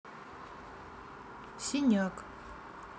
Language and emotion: Russian, neutral